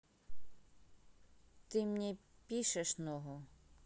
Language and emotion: Russian, neutral